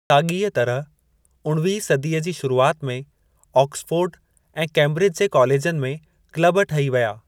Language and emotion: Sindhi, neutral